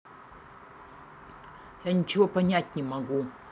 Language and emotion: Russian, angry